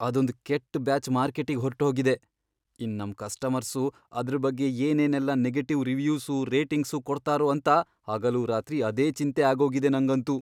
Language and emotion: Kannada, fearful